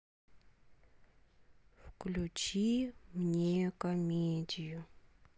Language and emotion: Russian, sad